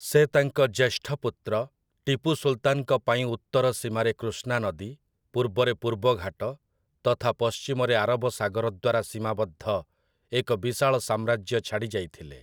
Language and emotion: Odia, neutral